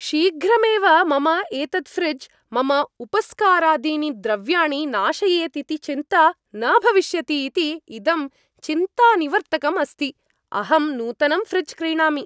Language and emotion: Sanskrit, happy